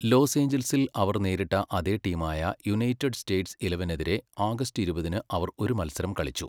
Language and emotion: Malayalam, neutral